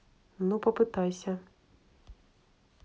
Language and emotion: Russian, neutral